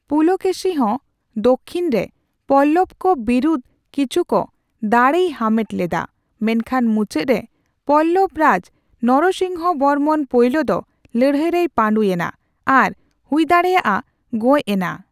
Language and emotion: Santali, neutral